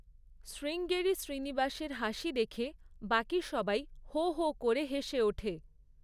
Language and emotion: Bengali, neutral